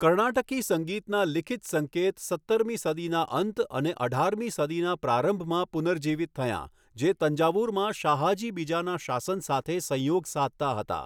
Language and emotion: Gujarati, neutral